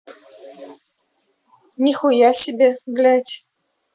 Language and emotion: Russian, angry